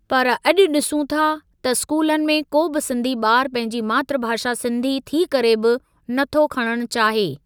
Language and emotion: Sindhi, neutral